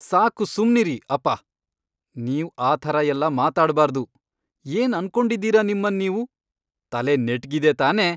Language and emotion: Kannada, angry